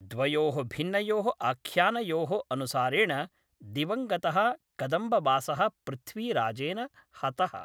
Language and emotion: Sanskrit, neutral